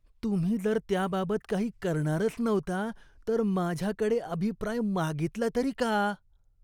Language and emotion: Marathi, disgusted